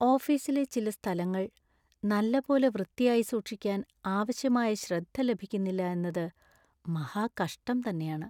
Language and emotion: Malayalam, sad